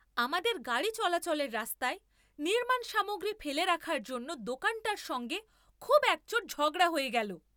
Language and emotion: Bengali, angry